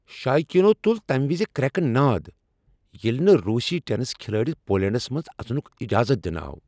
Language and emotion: Kashmiri, angry